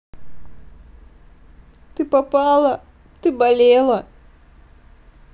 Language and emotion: Russian, sad